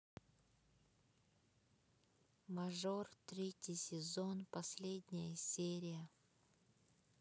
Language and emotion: Russian, sad